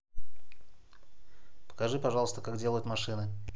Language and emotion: Russian, neutral